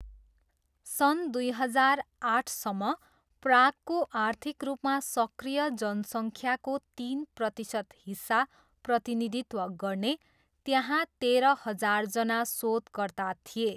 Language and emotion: Nepali, neutral